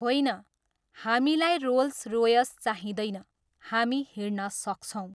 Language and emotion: Nepali, neutral